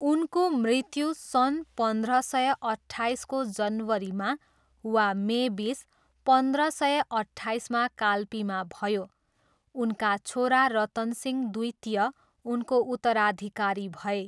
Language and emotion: Nepali, neutral